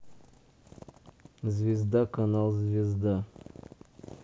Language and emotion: Russian, neutral